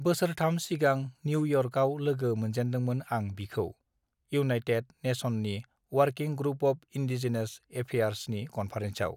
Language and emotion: Bodo, neutral